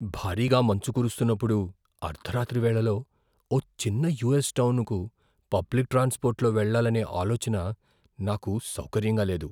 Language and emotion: Telugu, fearful